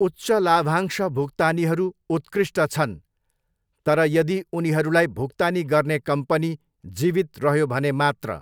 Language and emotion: Nepali, neutral